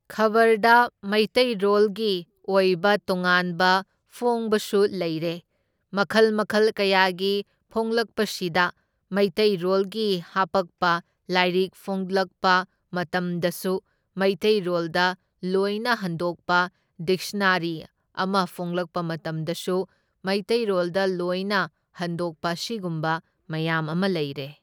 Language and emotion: Manipuri, neutral